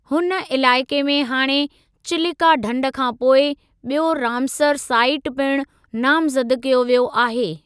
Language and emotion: Sindhi, neutral